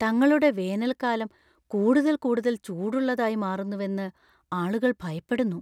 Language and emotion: Malayalam, fearful